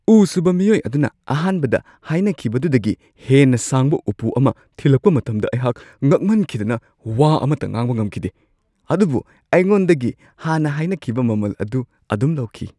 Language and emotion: Manipuri, surprised